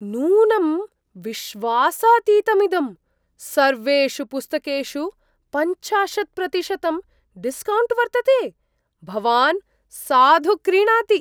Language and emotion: Sanskrit, surprised